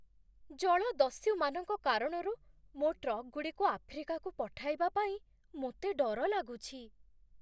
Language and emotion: Odia, fearful